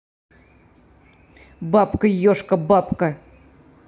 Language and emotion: Russian, angry